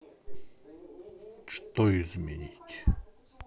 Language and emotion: Russian, neutral